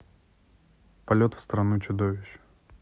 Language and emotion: Russian, neutral